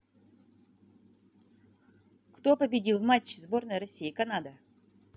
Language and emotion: Russian, positive